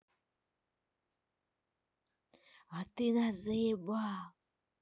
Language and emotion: Russian, angry